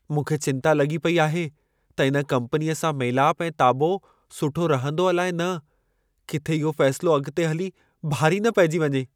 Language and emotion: Sindhi, fearful